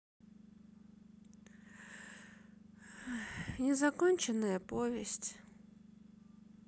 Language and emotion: Russian, sad